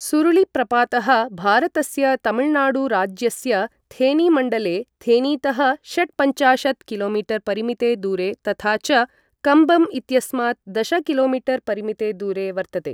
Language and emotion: Sanskrit, neutral